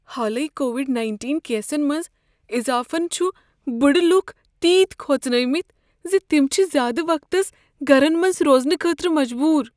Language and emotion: Kashmiri, fearful